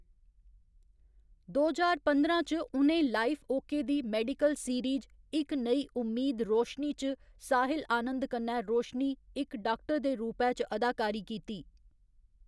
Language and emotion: Dogri, neutral